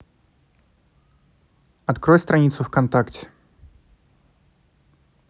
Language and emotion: Russian, neutral